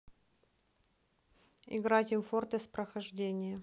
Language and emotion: Russian, neutral